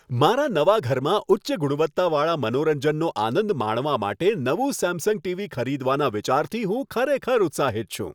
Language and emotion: Gujarati, happy